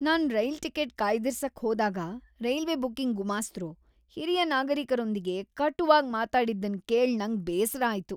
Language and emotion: Kannada, disgusted